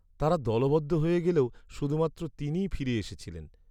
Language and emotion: Bengali, sad